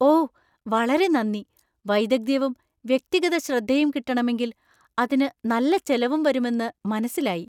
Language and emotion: Malayalam, surprised